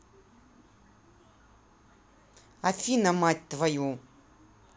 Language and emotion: Russian, angry